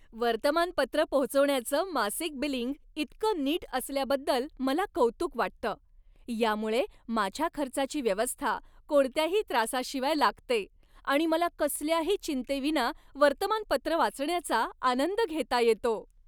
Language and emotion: Marathi, happy